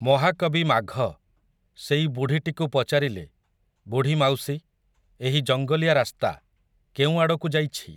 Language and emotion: Odia, neutral